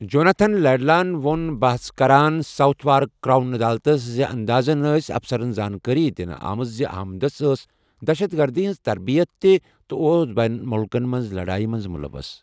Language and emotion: Kashmiri, neutral